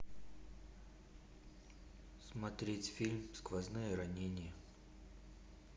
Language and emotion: Russian, neutral